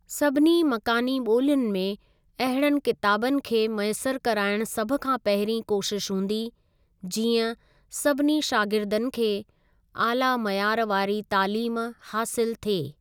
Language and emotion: Sindhi, neutral